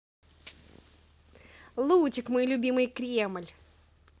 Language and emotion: Russian, positive